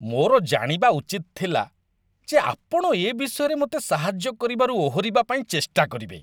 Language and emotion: Odia, disgusted